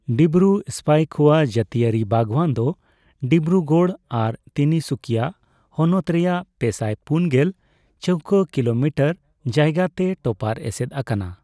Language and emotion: Santali, neutral